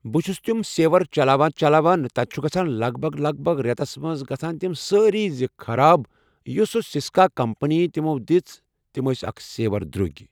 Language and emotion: Kashmiri, neutral